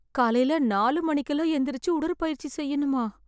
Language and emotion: Tamil, fearful